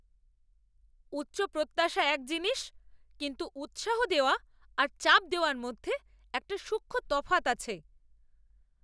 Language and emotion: Bengali, angry